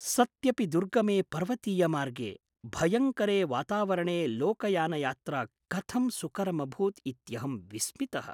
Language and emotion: Sanskrit, surprised